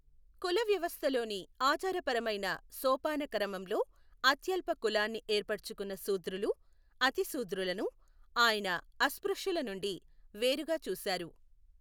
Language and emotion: Telugu, neutral